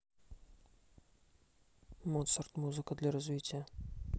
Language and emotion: Russian, neutral